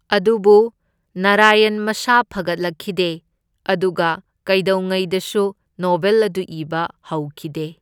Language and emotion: Manipuri, neutral